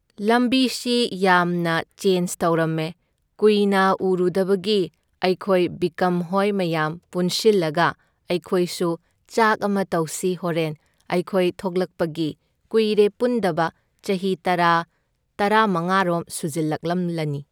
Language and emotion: Manipuri, neutral